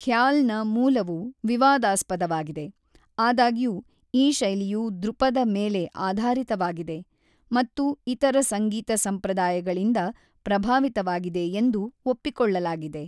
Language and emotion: Kannada, neutral